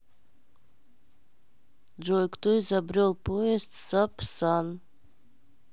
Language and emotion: Russian, neutral